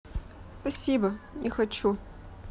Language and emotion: Russian, sad